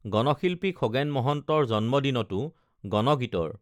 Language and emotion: Assamese, neutral